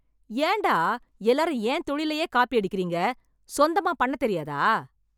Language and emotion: Tamil, angry